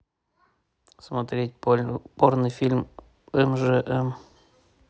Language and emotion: Russian, neutral